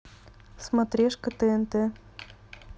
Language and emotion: Russian, neutral